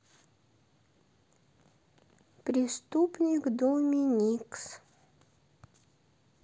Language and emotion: Russian, neutral